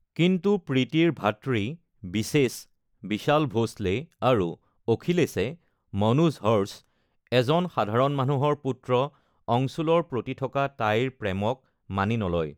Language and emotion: Assamese, neutral